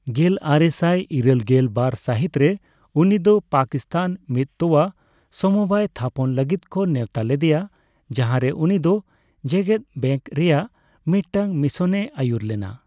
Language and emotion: Santali, neutral